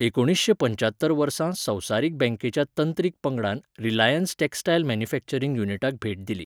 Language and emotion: Goan Konkani, neutral